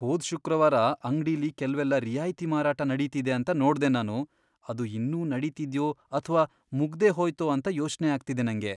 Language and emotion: Kannada, fearful